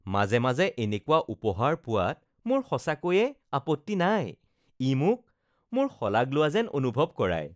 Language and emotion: Assamese, happy